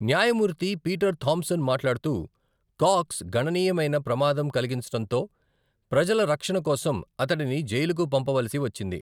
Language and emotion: Telugu, neutral